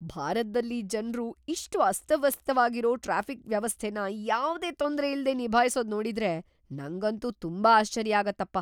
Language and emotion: Kannada, surprised